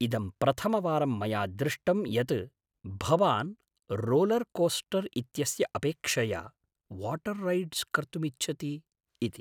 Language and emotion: Sanskrit, surprised